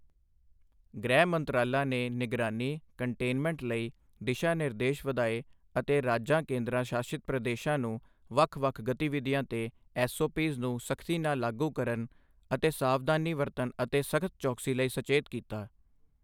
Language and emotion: Punjabi, neutral